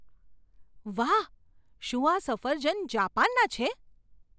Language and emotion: Gujarati, surprised